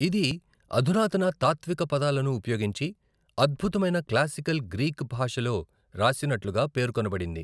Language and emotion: Telugu, neutral